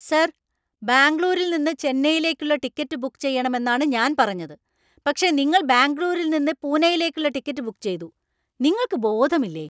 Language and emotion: Malayalam, angry